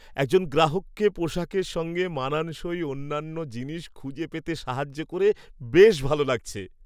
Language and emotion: Bengali, happy